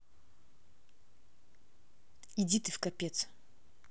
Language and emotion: Russian, angry